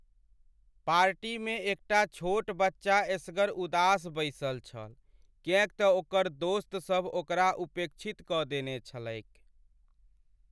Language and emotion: Maithili, sad